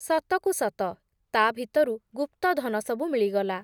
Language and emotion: Odia, neutral